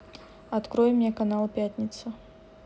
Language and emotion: Russian, neutral